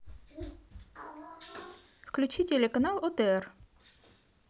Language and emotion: Russian, positive